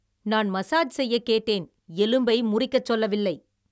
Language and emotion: Tamil, angry